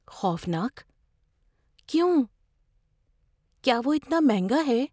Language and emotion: Urdu, fearful